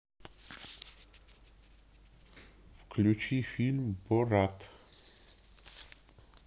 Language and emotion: Russian, neutral